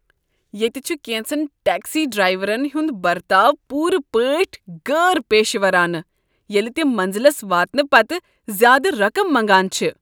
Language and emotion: Kashmiri, disgusted